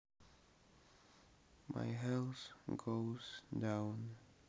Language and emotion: Russian, sad